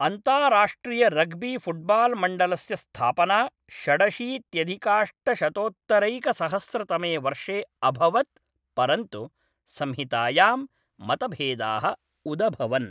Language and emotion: Sanskrit, neutral